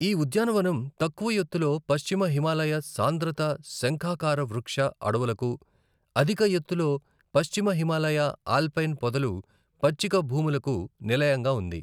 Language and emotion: Telugu, neutral